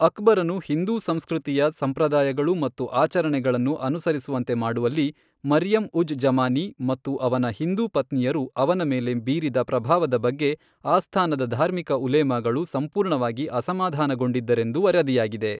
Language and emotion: Kannada, neutral